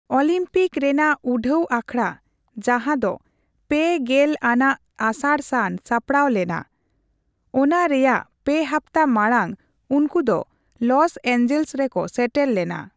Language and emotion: Santali, neutral